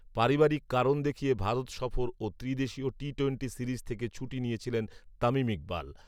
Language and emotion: Bengali, neutral